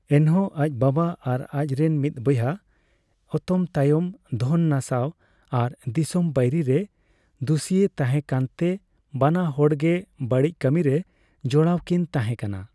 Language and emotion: Santali, neutral